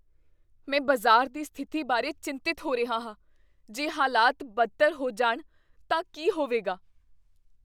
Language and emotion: Punjabi, fearful